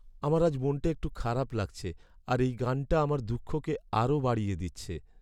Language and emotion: Bengali, sad